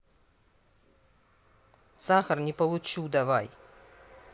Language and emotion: Russian, angry